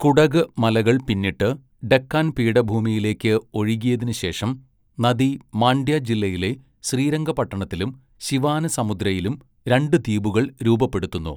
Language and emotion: Malayalam, neutral